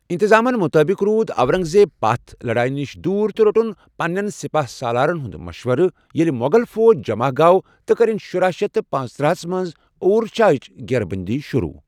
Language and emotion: Kashmiri, neutral